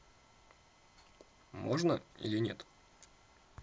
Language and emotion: Russian, neutral